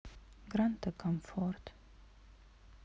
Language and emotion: Russian, sad